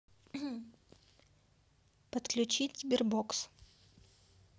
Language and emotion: Russian, neutral